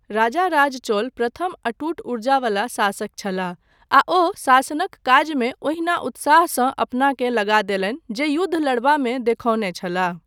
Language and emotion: Maithili, neutral